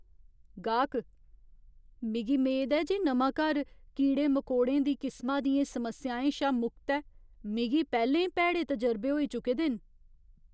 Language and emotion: Dogri, fearful